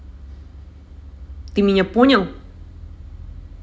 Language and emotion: Russian, angry